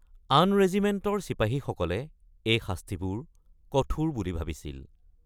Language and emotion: Assamese, neutral